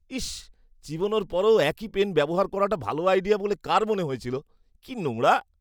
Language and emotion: Bengali, disgusted